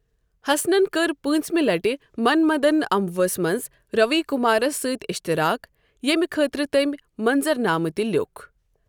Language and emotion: Kashmiri, neutral